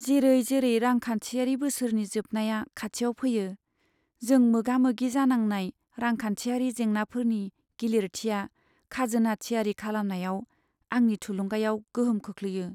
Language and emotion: Bodo, sad